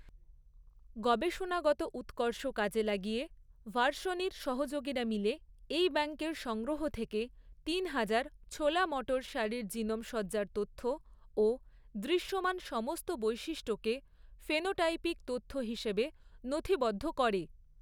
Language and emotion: Bengali, neutral